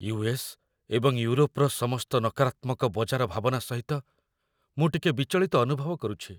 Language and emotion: Odia, fearful